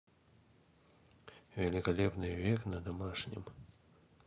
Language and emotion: Russian, neutral